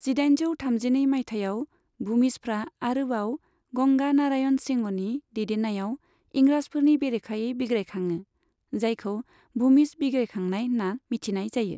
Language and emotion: Bodo, neutral